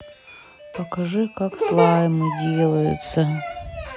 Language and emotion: Russian, sad